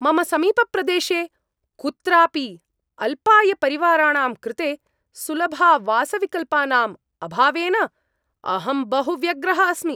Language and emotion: Sanskrit, angry